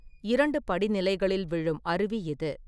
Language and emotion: Tamil, neutral